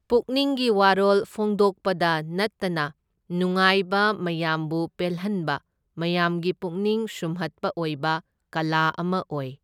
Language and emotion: Manipuri, neutral